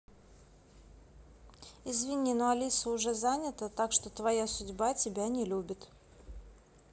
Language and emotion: Russian, neutral